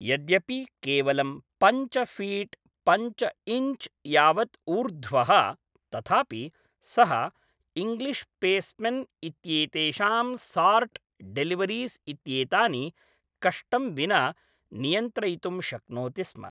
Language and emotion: Sanskrit, neutral